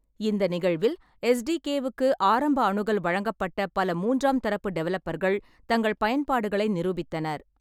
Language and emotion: Tamil, neutral